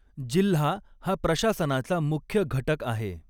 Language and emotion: Marathi, neutral